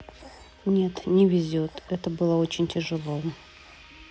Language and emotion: Russian, sad